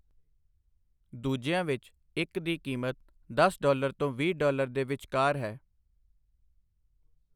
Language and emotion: Punjabi, neutral